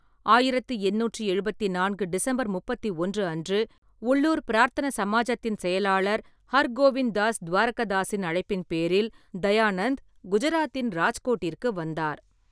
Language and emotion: Tamil, neutral